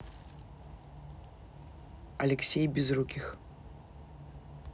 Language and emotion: Russian, neutral